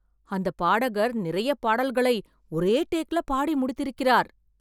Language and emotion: Tamil, surprised